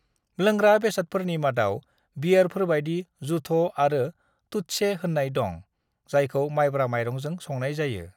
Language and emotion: Bodo, neutral